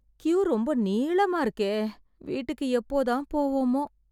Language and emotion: Tamil, sad